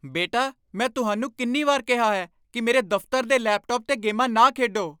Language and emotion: Punjabi, angry